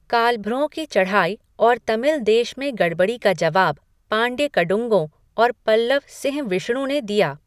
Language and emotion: Hindi, neutral